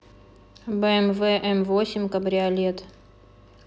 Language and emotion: Russian, neutral